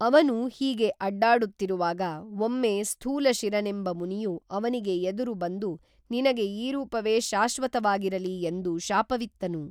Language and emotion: Kannada, neutral